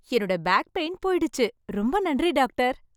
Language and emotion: Tamil, happy